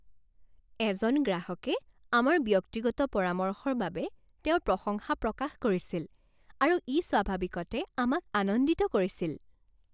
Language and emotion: Assamese, happy